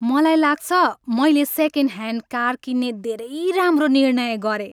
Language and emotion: Nepali, happy